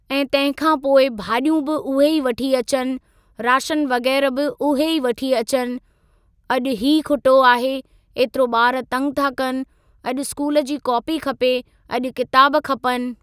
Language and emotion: Sindhi, neutral